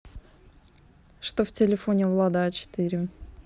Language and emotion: Russian, neutral